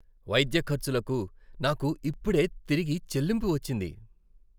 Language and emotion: Telugu, happy